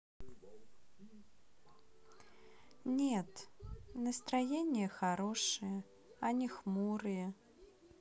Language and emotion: Russian, neutral